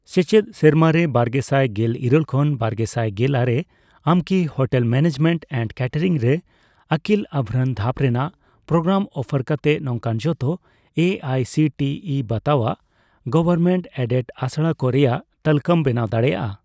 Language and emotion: Santali, neutral